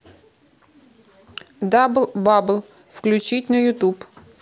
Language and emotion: Russian, neutral